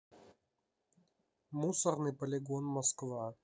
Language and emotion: Russian, neutral